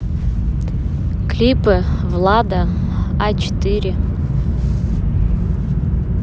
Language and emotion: Russian, neutral